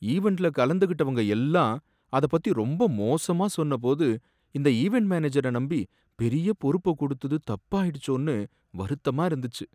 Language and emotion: Tamil, sad